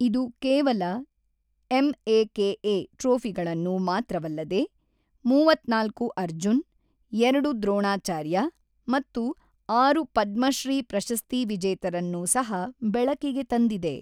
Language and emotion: Kannada, neutral